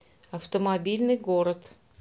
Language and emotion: Russian, neutral